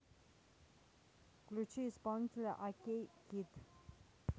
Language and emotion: Russian, neutral